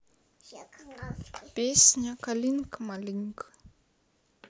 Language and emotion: Russian, sad